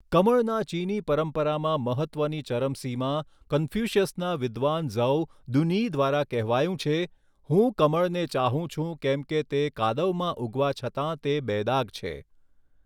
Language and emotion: Gujarati, neutral